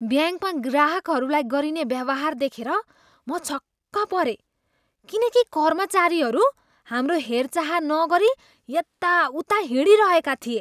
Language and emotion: Nepali, disgusted